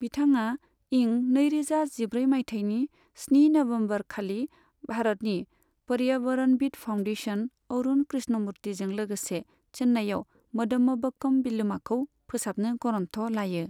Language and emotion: Bodo, neutral